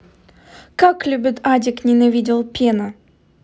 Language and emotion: Russian, neutral